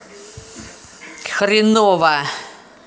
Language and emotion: Russian, angry